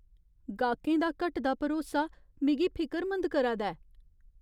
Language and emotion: Dogri, fearful